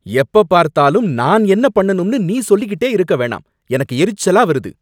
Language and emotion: Tamil, angry